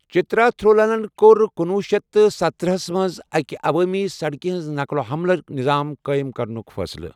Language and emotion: Kashmiri, neutral